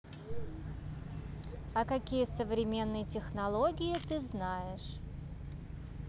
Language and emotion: Russian, neutral